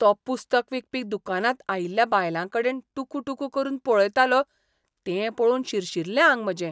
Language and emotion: Goan Konkani, disgusted